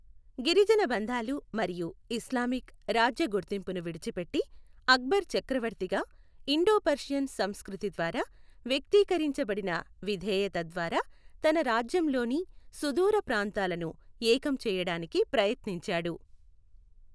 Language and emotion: Telugu, neutral